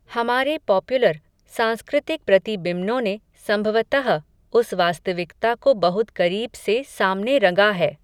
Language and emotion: Hindi, neutral